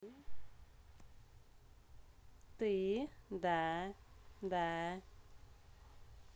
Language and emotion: Russian, positive